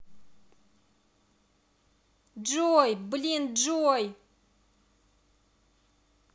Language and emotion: Russian, angry